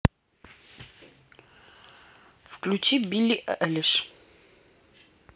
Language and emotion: Russian, neutral